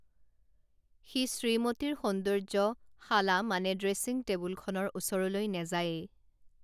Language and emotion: Assamese, neutral